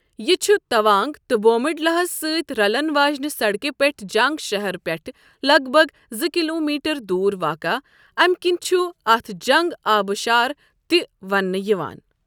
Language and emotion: Kashmiri, neutral